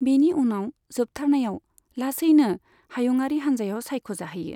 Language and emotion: Bodo, neutral